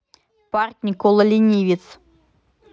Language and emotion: Russian, neutral